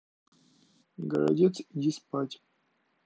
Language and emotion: Russian, neutral